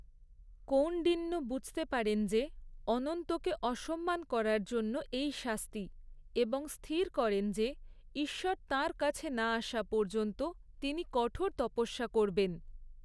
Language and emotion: Bengali, neutral